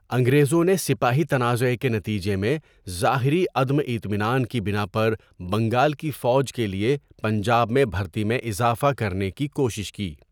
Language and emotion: Urdu, neutral